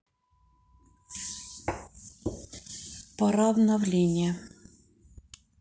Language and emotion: Russian, neutral